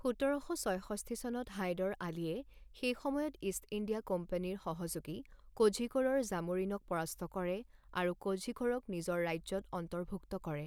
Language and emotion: Assamese, neutral